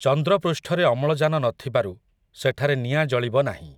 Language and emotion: Odia, neutral